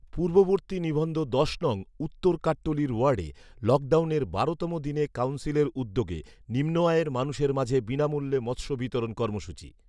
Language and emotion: Bengali, neutral